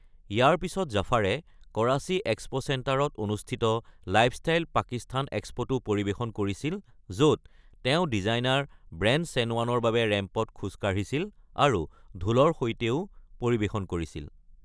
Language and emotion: Assamese, neutral